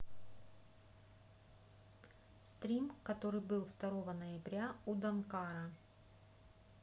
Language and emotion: Russian, neutral